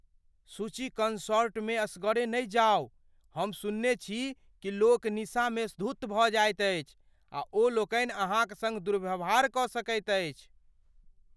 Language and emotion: Maithili, fearful